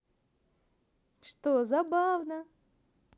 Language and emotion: Russian, positive